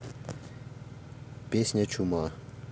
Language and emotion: Russian, neutral